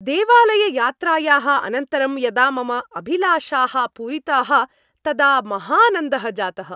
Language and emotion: Sanskrit, happy